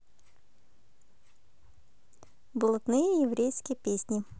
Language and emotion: Russian, positive